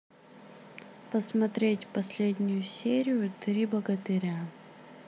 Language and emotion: Russian, sad